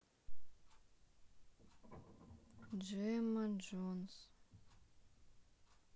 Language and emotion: Russian, sad